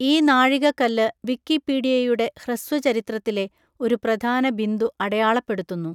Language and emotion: Malayalam, neutral